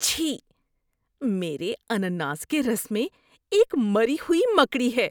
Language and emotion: Urdu, disgusted